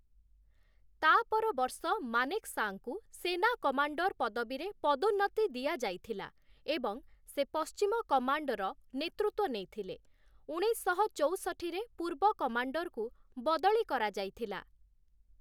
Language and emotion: Odia, neutral